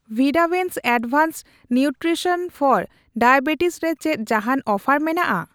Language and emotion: Santali, neutral